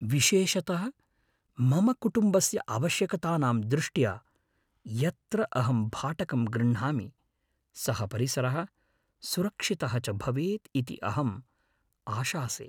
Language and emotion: Sanskrit, fearful